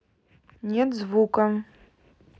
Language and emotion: Russian, neutral